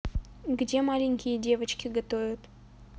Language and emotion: Russian, neutral